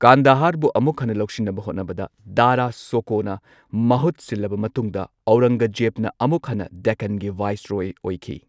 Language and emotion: Manipuri, neutral